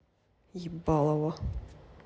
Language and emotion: Russian, angry